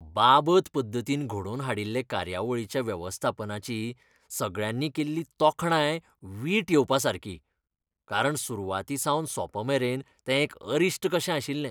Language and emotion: Goan Konkani, disgusted